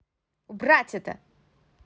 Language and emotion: Russian, angry